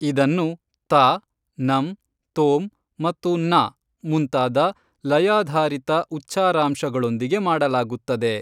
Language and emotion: Kannada, neutral